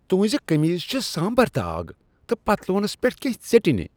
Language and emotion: Kashmiri, disgusted